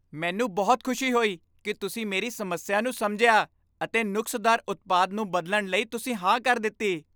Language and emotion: Punjabi, happy